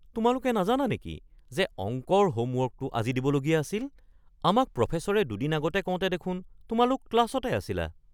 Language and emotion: Assamese, surprised